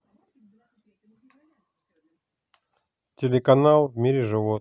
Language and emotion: Russian, neutral